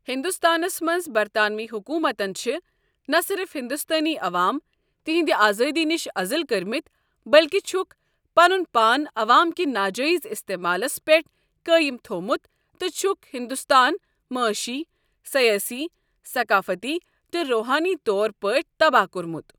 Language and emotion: Kashmiri, neutral